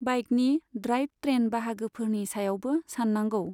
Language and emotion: Bodo, neutral